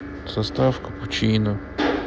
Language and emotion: Russian, sad